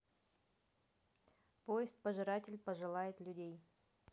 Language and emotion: Russian, neutral